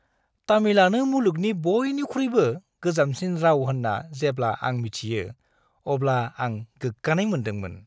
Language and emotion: Bodo, happy